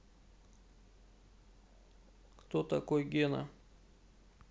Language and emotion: Russian, neutral